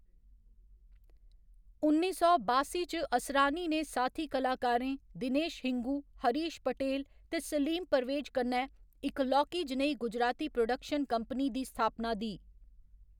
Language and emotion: Dogri, neutral